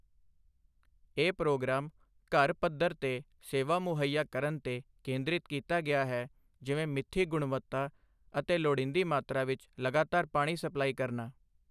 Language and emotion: Punjabi, neutral